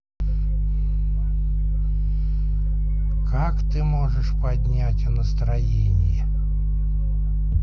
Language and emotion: Russian, neutral